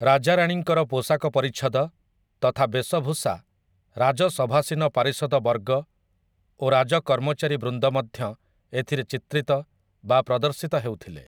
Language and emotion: Odia, neutral